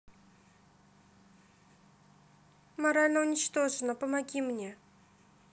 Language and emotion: Russian, sad